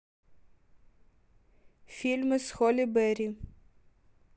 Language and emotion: Russian, neutral